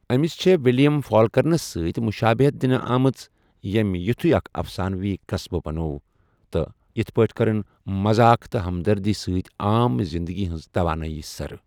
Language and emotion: Kashmiri, neutral